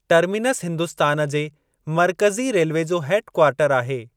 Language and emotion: Sindhi, neutral